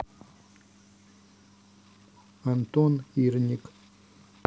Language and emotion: Russian, neutral